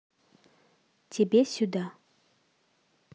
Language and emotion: Russian, neutral